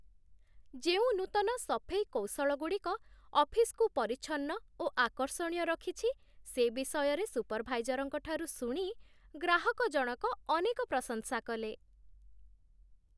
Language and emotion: Odia, happy